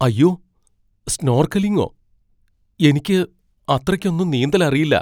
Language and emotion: Malayalam, fearful